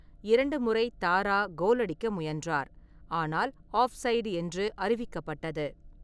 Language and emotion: Tamil, neutral